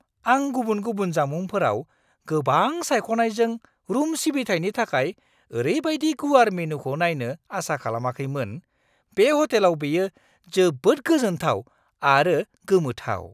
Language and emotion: Bodo, surprised